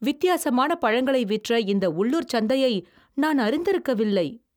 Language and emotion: Tamil, surprised